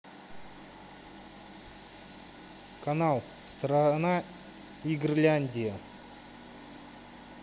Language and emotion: Russian, neutral